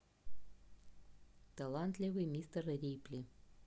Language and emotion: Russian, neutral